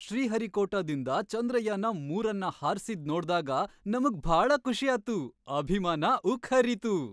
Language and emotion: Kannada, happy